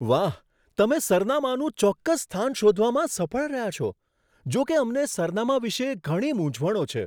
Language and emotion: Gujarati, surprised